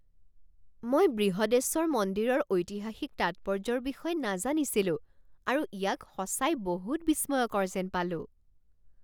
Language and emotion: Assamese, surprised